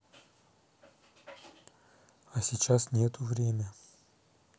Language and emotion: Russian, neutral